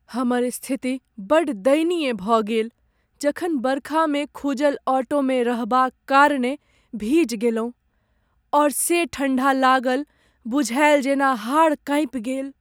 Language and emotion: Maithili, sad